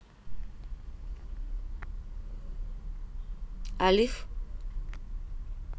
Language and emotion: Russian, neutral